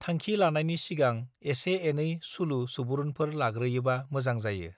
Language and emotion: Bodo, neutral